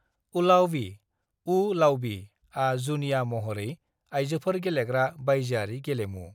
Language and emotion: Bodo, neutral